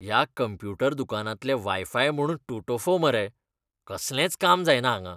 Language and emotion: Goan Konkani, disgusted